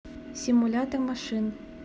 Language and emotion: Russian, neutral